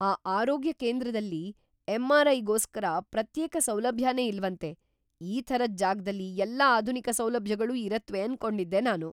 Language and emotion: Kannada, surprised